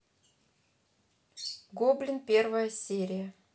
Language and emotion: Russian, neutral